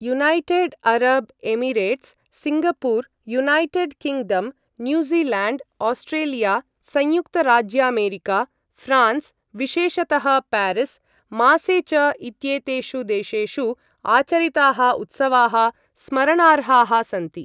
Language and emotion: Sanskrit, neutral